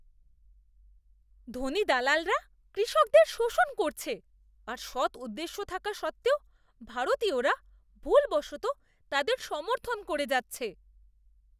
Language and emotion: Bengali, disgusted